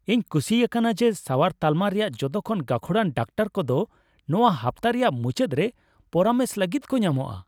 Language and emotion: Santali, happy